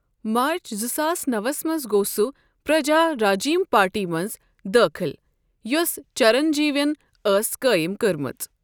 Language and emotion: Kashmiri, neutral